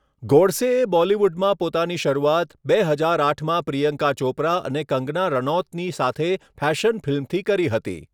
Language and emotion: Gujarati, neutral